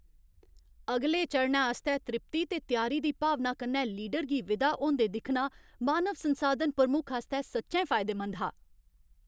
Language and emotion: Dogri, happy